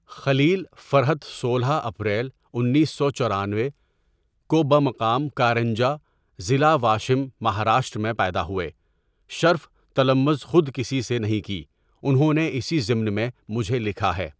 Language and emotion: Urdu, neutral